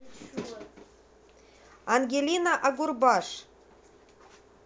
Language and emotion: Russian, positive